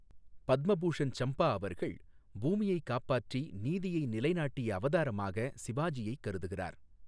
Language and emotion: Tamil, neutral